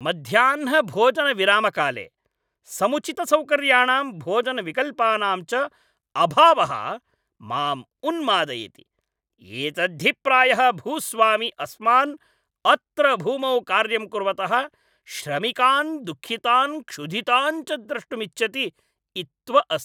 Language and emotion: Sanskrit, angry